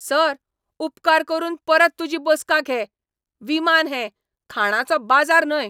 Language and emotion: Goan Konkani, angry